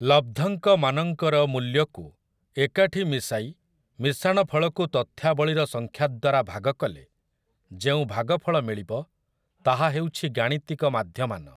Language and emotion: Odia, neutral